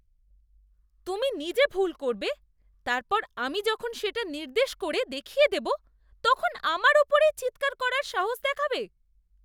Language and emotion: Bengali, disgusted